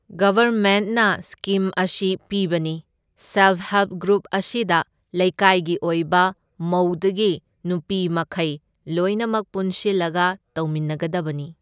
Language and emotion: Manipuri, neutral